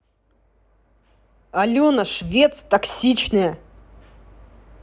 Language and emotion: Russian, angry